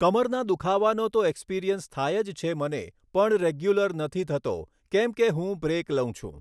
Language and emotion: Gujarati, neutral